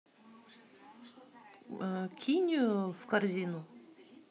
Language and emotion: Russian, neutral